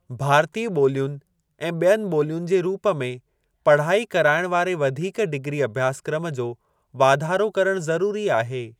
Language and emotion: Sindhi, neutral